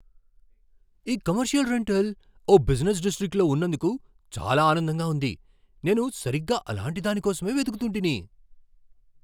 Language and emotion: Telugu, surprised